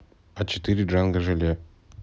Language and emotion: Russian, neutral